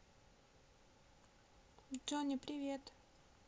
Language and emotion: Russian, neutral